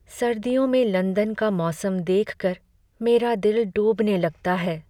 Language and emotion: Hindi, sad